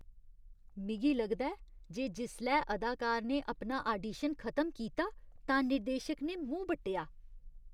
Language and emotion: Dogri, disgusted